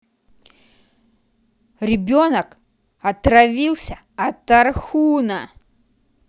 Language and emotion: Russian, angry